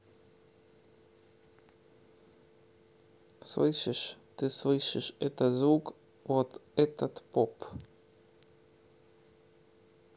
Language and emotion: Russian, neutral